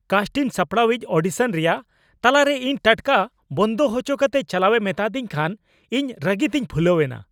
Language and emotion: Santali, angry